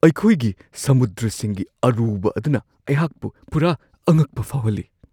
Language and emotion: Manipuri, surprised